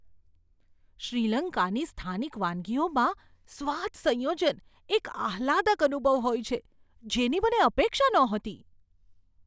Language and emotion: Gujarati, surprised